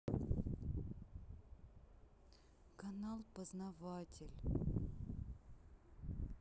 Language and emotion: Russian, sad